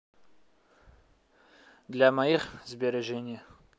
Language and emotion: Russian, neutral